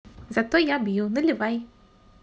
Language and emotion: Russian, positive